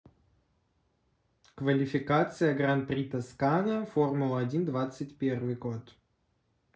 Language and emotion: Russian, neutral